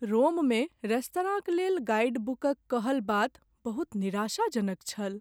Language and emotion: Maithili, sad